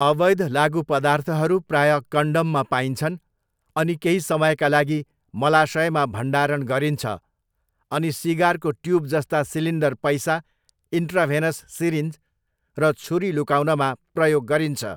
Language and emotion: Nepali, neutral